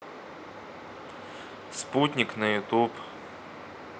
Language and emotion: Russian, neutral